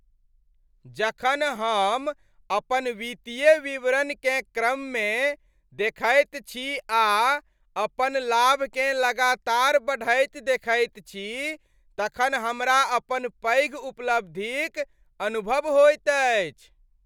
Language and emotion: Maithili, happy